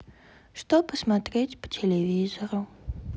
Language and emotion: Russian, sad